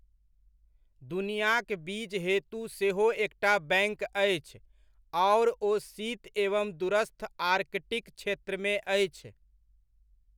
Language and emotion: Maithili, neutral